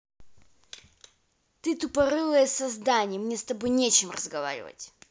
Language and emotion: Russian, angry